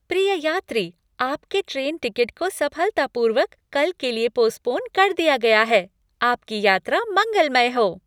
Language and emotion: Hindi, happy